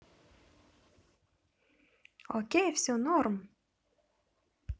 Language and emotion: Russian, positive